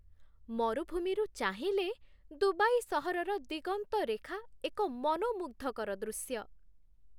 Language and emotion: Odia, happy